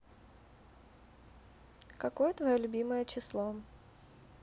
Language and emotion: Russian, neutral